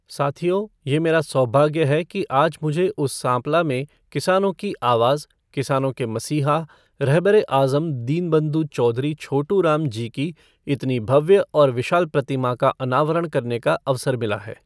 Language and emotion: Hindi, neutral